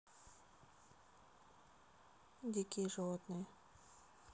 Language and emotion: Russian, neutral